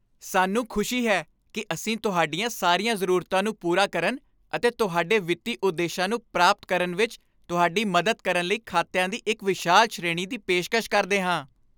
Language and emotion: Punjabi, happy